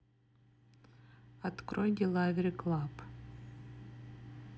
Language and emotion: Russian, neutral